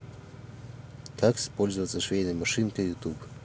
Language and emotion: Russian, neutral